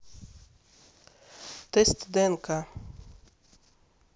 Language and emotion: Russian, neutral